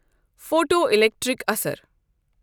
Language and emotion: Kashmiri, neutral